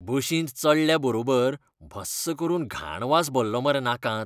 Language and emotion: Goan Konkani, disgusted